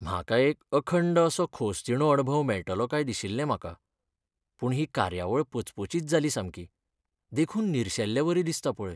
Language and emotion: Goan Konkani, sad